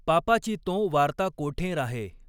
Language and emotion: Marathi, neutral